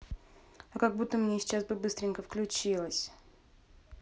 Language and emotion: Russian, neutral